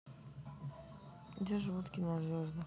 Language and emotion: Russian, neutral